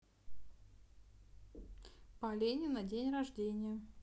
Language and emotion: Russian, neutral